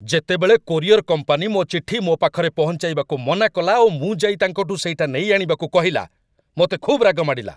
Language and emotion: Odia, angry